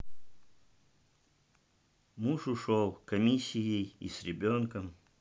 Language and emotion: Russian, sad